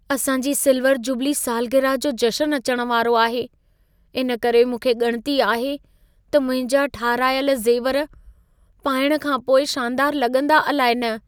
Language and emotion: Sindhi, fearful